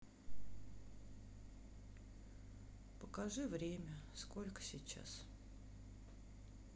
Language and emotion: Russian, sad